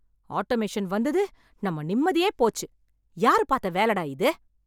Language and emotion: Tamil, angry